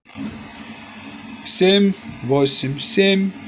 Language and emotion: Russian, positive